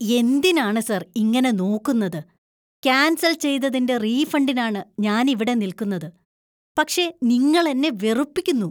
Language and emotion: Malayalam, disgusted